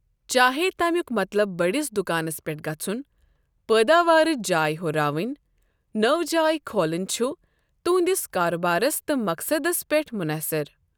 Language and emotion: Kashmiri, neutral